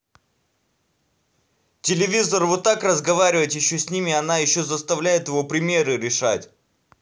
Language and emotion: Russian, angry